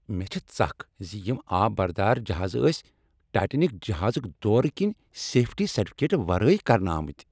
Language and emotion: Kashmiri, angry